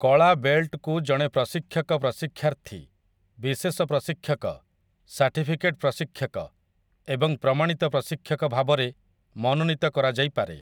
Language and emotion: Odia, neutral